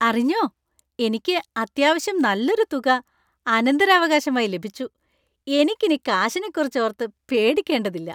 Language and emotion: Malayalam, happy